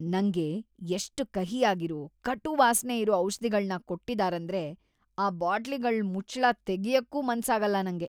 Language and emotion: Kannada, disgusted